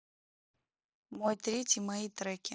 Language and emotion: Russian, neutral